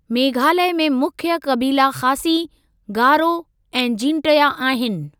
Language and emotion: Sindhi, neutral